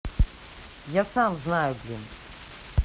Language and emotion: Russian, angry